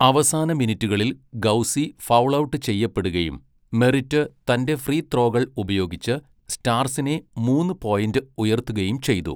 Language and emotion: Malayalam, neutral